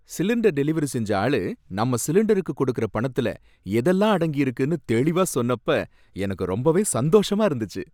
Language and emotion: Tamil, happy